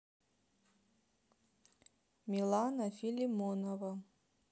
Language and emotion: Russian, neutral